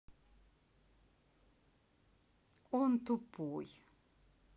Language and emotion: Russian, neutral